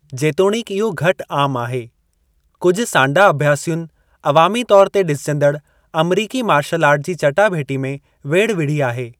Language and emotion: Sindhi, neutral